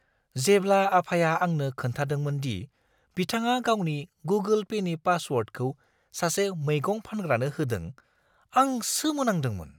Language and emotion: Bodo, surprised